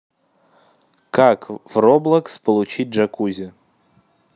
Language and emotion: Russian, neutral